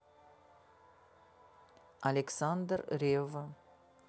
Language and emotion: Russian, neutral